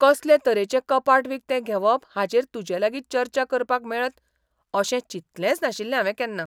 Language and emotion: Goan Konkani, surprised